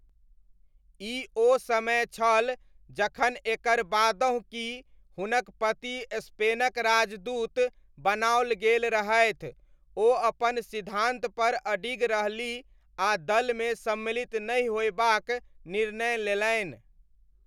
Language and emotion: Maithili, neutral